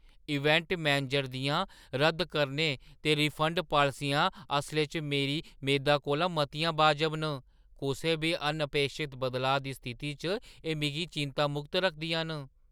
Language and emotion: Dogri, surprised